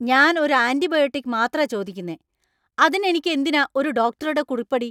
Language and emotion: Malayalam, angry